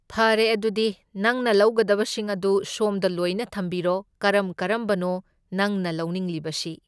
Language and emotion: Manipuri, neutral